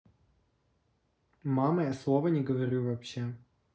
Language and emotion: Russian, neutral